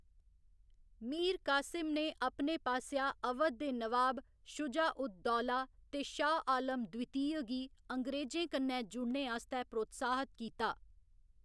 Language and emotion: Dogri, neutral